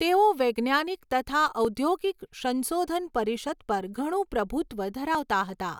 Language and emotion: Gujarati, neutral